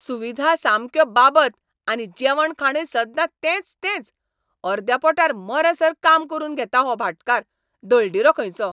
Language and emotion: Goan Konkani, angry